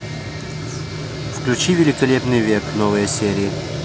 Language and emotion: Russian, neutral